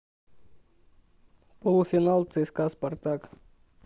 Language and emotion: Russian, neutral